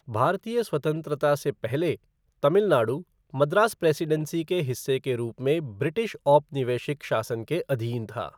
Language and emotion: Hindi, neutral